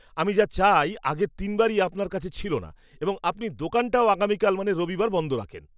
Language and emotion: Bengali, disgusted